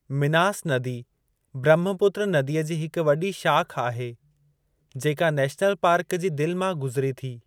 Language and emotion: Sindhi, neutral